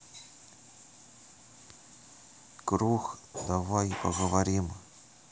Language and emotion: Russian, neutral